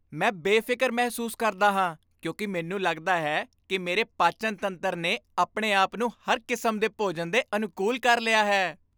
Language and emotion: Punjabi, happy